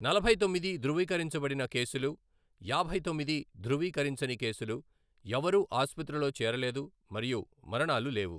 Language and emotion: Telugu, neutral